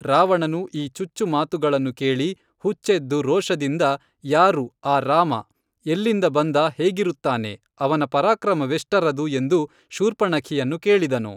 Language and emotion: Kannada, neutral